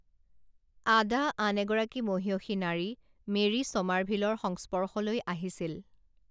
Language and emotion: Assamese, neutral